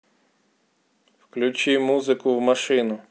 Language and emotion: Russian, neutral